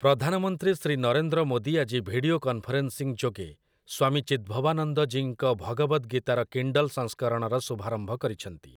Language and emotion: Odia, neutral